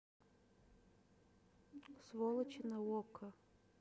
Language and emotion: Russian, neutral